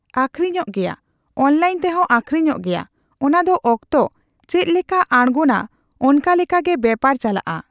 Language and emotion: Santali, neutral